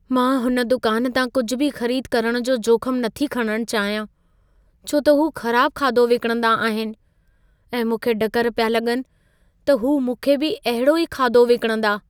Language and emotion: Sindhi, fearful